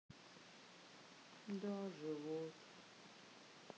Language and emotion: Russian, sad